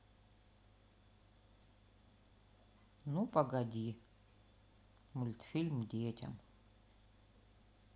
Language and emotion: Russian, neutral